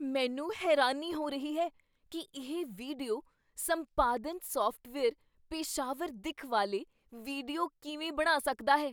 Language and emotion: Punjabi, surprised